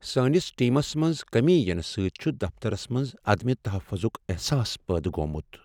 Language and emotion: Kashmiri, sad